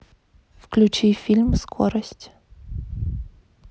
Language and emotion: Russian, neutral